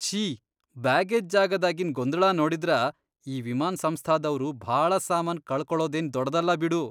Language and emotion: Kannada, disgusted